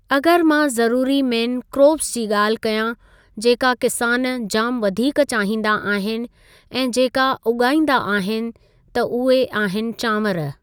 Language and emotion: Sindhi, neutral